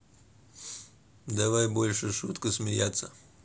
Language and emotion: Russian, neutral